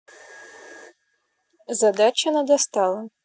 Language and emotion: Russian, neutral